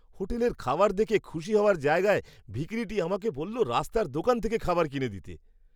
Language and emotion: Bengali, surprised